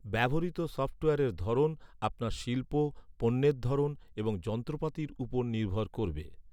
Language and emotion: Bengali, neutral